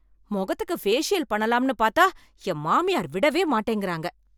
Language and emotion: Tamil, angry